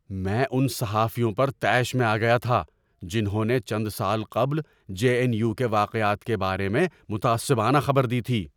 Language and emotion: Urdu, angry